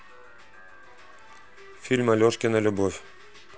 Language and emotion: Russian, neutral